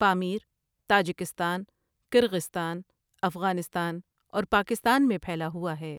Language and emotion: Urdu, neutral